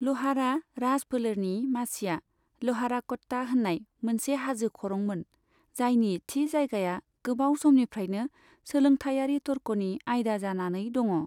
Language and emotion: Bodo, neutral